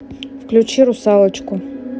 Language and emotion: Russian, neutral